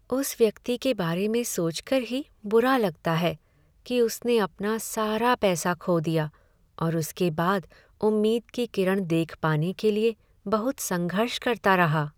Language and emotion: Hindi, sad